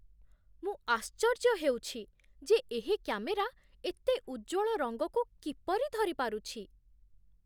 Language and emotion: Odia, surprised